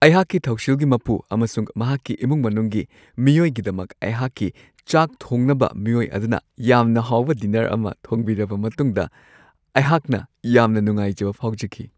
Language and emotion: Manipuri, happy